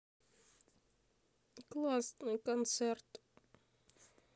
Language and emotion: Russian, sad